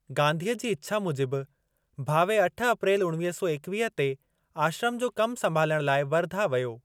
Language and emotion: Sindhi, neutral